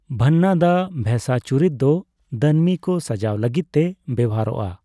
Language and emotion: Santali, neutral